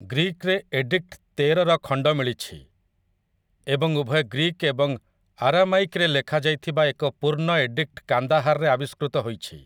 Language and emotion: Odia, neutral